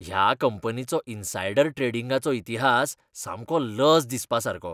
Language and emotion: Goan Konkani, disgusted